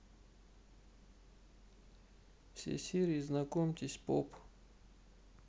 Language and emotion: Russian, neutral